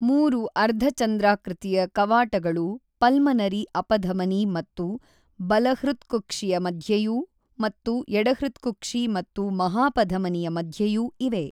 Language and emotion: Kannada, neutral